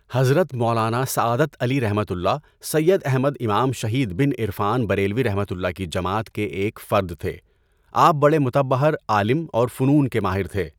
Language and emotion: Urdu, neutral